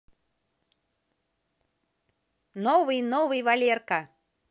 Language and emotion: Russian, positive